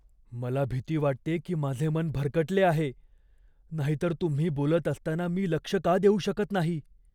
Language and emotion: Marathi, fearful